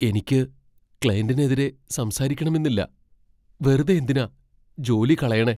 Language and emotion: Malayalam, fearful